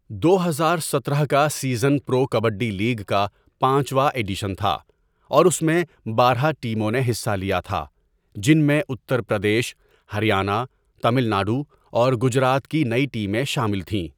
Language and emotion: Urdu, neutral